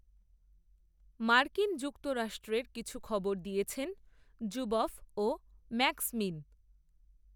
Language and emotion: Bengali, neutral